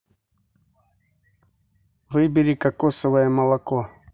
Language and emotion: Russian, neutral